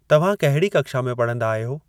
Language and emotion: Sindhi, neutral